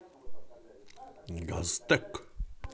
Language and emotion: Russian, positive